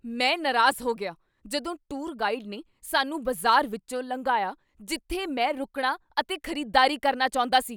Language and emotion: Punjabi, angry